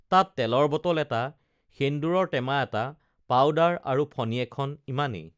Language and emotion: Assamese, neutral